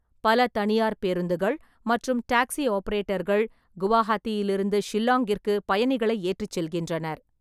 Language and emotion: Tamil, neutral